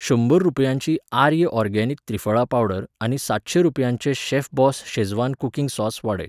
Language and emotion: Goan Konkani, neutral